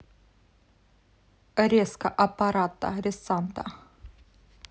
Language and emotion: Russian, neutral